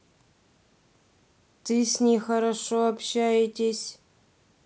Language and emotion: Russian, neutral